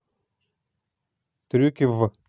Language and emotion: Russian, neutral